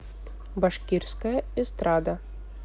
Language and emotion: Russian, neutral